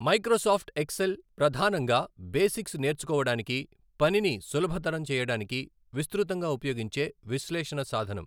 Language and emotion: Telugu, neutral